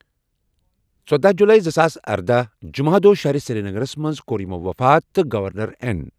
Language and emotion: Kashmiri, neutral